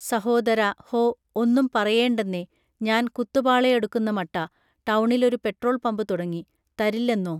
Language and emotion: Malayalam, neutral